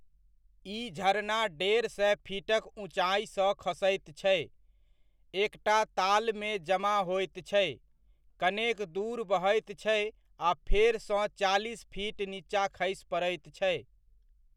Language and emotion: Maithili, neutral